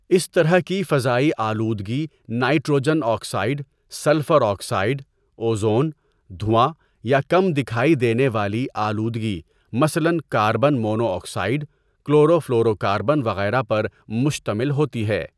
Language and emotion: Urdu, neutral